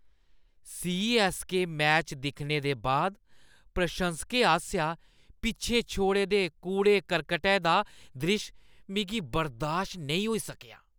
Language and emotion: Dogri, disgusted